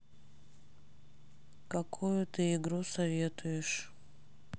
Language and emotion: Russian, sad